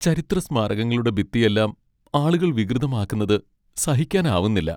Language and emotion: Malayalam, sad